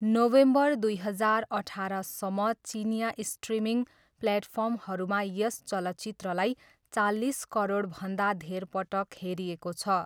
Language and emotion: Nepali, neutral